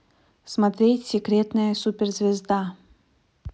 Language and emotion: Russian, neutral